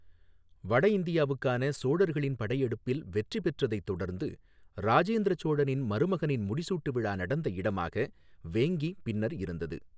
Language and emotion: Tamil, neutral